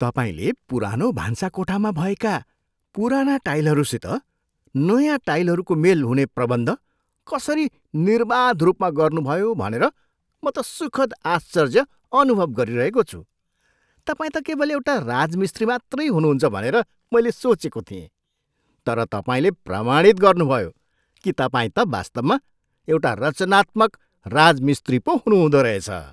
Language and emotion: Nepali, surprised